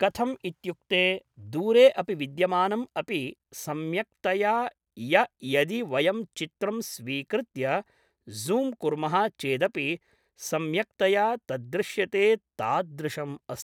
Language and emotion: Sanskrit, neutral